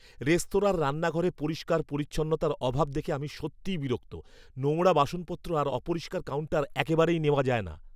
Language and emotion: Bengali, angry